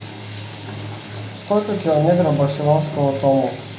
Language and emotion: Russian, neutral